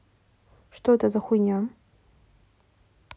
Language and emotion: Russian, angry